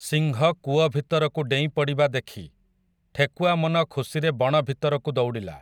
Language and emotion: Odia, neutral